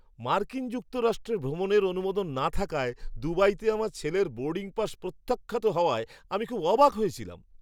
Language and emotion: Bengali, surprised